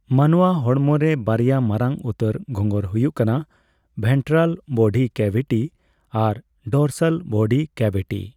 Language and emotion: Santali, neutral